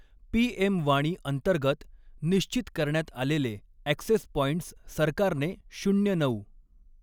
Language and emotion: Marathi, neutral